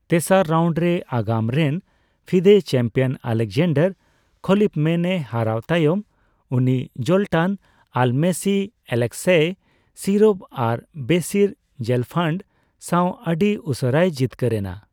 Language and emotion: Santali, neutral